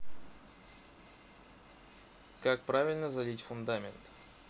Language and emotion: Russian, neutral